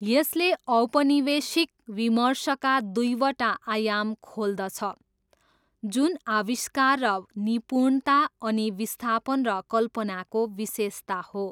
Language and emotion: Nepali, neutral